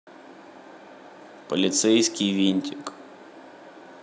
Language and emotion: Russian, neutral